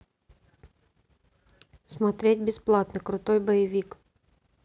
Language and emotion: Russian, neutral